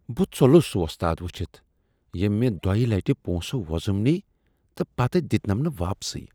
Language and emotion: Kashmiri, disgusted